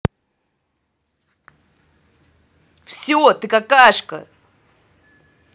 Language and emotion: Russian, angry